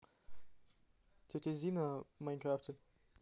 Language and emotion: Russian, neutral